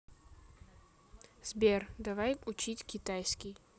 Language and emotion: Russian, neutral